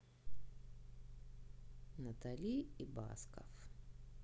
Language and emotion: Russian, neutral